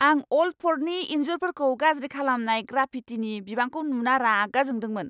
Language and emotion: Bodo, angry